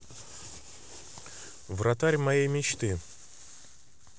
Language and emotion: Russian, neutral